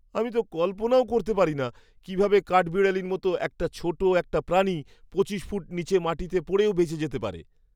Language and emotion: Bengali, surprised